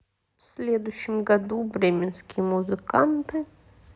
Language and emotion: Russian, neutral